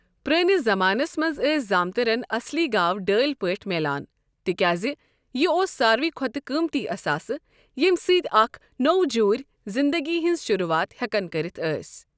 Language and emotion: Kashmiri, neutral